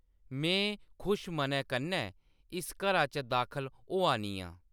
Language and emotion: Dogri, neutral